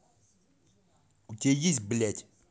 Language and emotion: Russian, angry